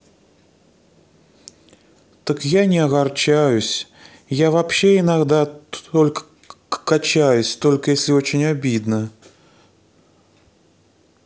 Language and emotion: Russian, sad